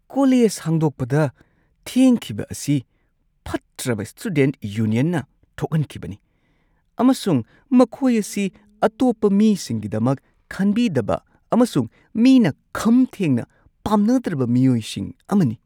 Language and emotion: Manipuri, disgusted